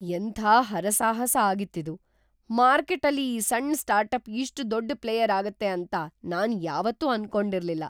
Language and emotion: Kannada, surprised